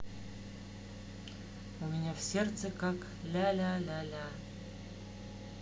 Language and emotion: Russian, sad